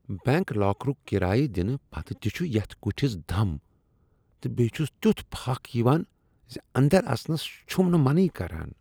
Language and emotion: Kashmiri, disgusted